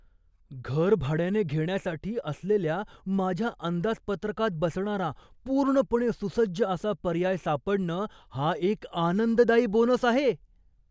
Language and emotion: Marathi, surprised